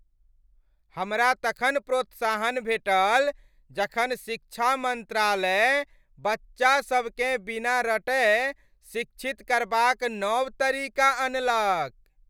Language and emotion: Maithili, happy